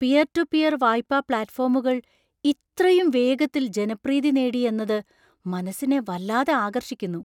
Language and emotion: Malayalam, surprised